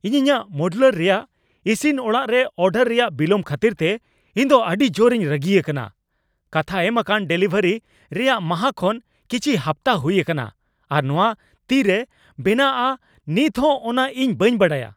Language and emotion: Santali, angry